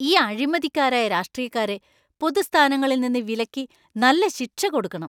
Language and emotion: Malayalam, angry